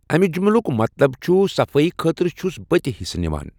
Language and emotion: Kashmiri, neutral